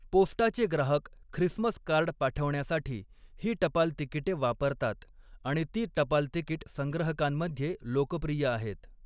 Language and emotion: Marathi, neutral